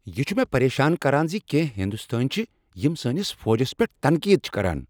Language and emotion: Kashmiri, angry